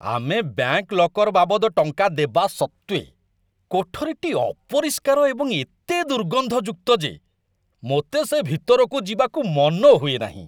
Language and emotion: Odia, disgusted